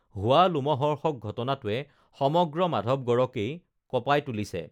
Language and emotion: Assamese, neutral